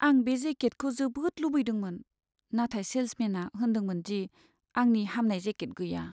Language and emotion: Bodo, sad